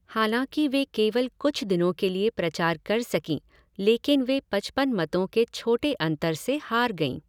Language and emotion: Hindi, neutral